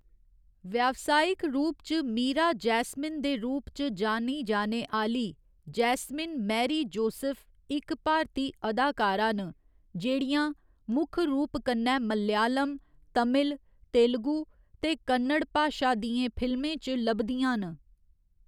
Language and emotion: Dogri, neutral